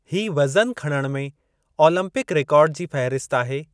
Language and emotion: Sindhi, neutral